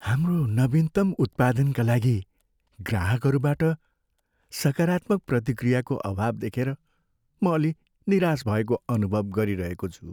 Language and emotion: Nepali, sad